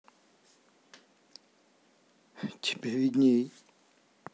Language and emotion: Russian, neutral